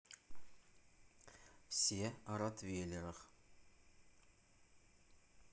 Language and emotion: Russian, neutral